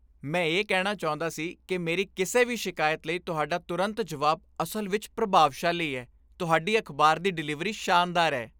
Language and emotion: Punjabi, happy